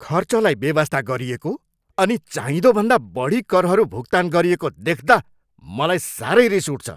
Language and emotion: Nepali, angry